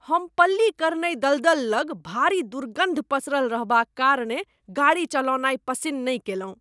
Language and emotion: Maithili, disgusted